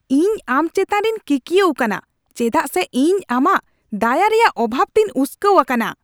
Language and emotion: Santali, angry